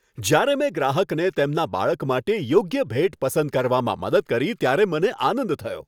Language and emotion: Gujarati, happy